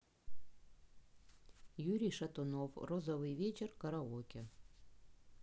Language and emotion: Russian, neutral